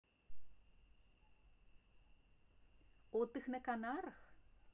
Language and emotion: Russian, positive